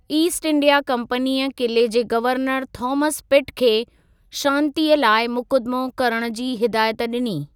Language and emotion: Sindhi, neutral